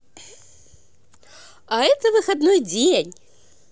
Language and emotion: Russian, positive